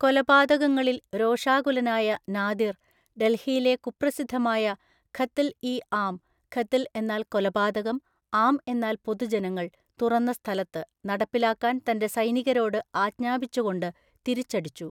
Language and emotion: Malayalam, neutral